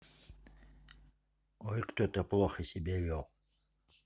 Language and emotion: Russian, neutral